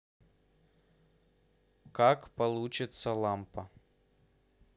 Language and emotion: Russian, neutral